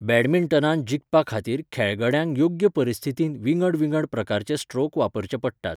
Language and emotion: Goan Konkani, neutral